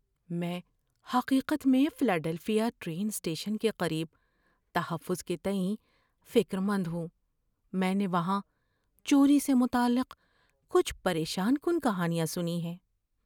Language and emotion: Urdu, fearful